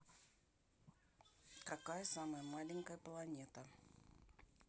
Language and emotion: Russian, neutral